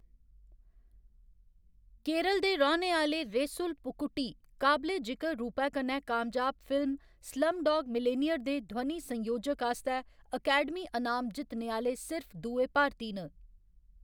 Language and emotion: Dogri, neutral